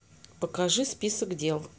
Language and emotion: Russian, neutral